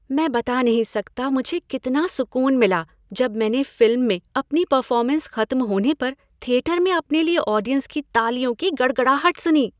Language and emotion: Hindi, happy